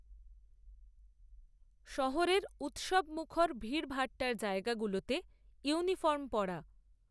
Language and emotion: Bengali, neutral